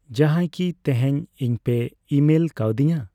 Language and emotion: Santali, neutral